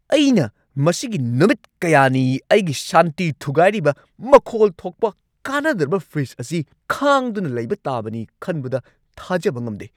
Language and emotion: Manipuri, angry